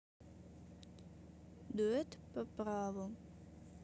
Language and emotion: Russian, neutral